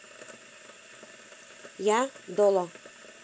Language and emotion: Russian, positive